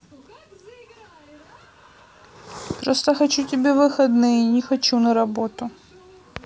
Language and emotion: Russian, sad